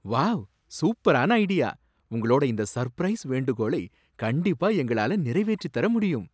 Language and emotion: Tamil, surprised